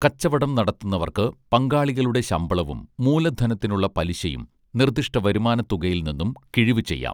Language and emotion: Malayalam, neutral